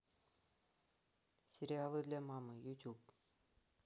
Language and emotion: Russian, neutral